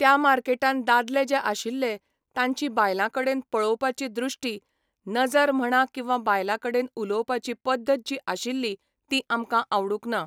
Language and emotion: Goan Konkani, neutral